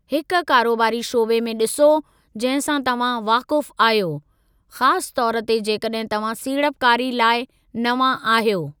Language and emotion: Sindhi, neutral